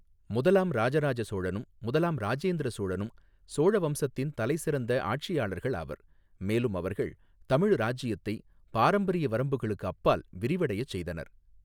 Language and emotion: Tamil, neutral